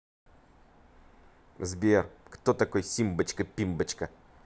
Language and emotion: Russian, positive